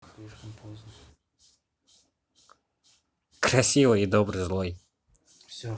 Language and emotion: Russian, neutral